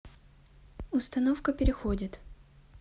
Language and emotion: Russian, neutral